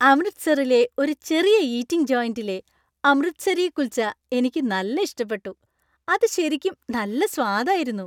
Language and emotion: Malayalam, happy